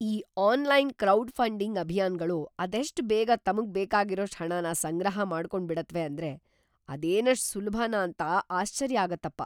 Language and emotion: Kannada, surprised